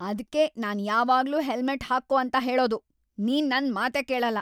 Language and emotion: Kannada, angry